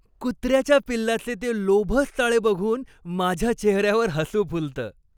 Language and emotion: Marathi, happy